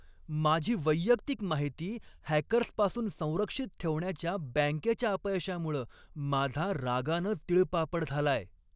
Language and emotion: Marathi, angry